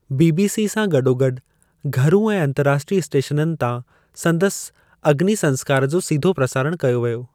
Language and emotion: Sindhi, neutral